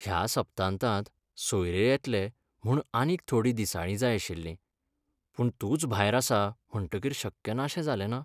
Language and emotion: Goan Konkani, sad